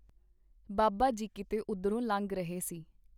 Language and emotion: Punjabi, neutral